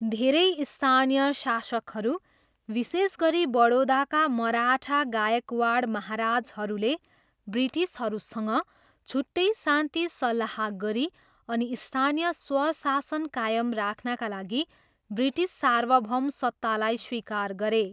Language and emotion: Nepali, neutral